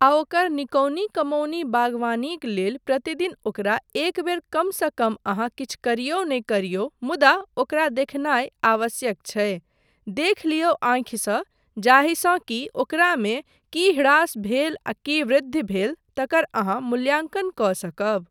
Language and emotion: Maithili, neutral